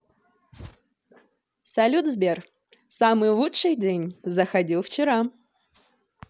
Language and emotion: Russian, positive